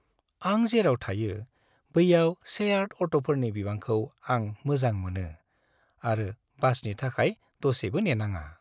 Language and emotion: Bodo, happy